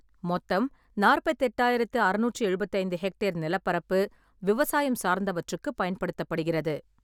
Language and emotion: Tamil, neutral